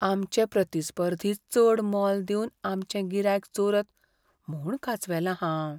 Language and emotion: Goan Konkani, fearful